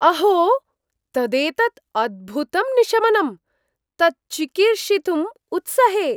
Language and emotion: Sanskrit, surprised